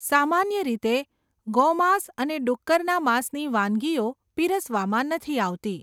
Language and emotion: Gujarati, neutral